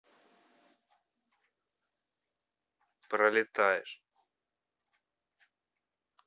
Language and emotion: Russian, neutral